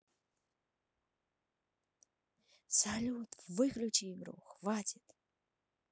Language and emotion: Russian, positive